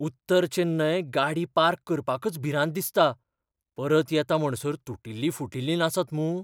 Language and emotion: Goan Konkani, fearful